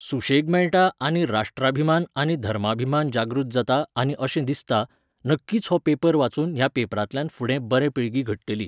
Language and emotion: Goan Konkani, neutral